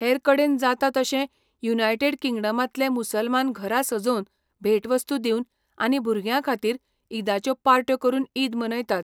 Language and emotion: Goan Konkani, neutral